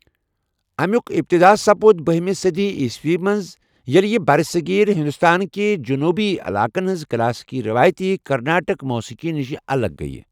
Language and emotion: Kashmiri, neutral